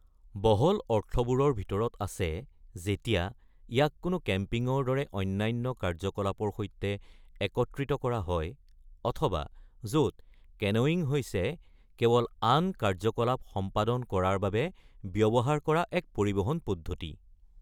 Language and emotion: Assamese, neutral